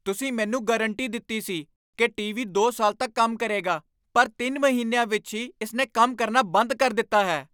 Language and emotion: Punjabi, angry